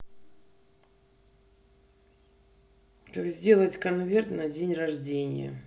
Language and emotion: Russian, neutral